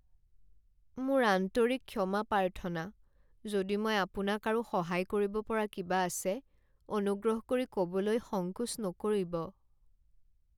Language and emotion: Assamese, sad